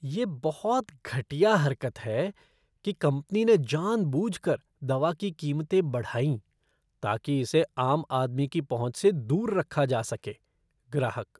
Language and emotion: Hindi, disgusted